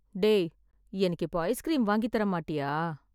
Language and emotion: Tamil, sad